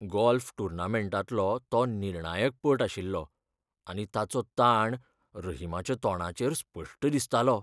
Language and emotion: Goan Konkani, fearful